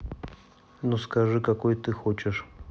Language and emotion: Russian, neutral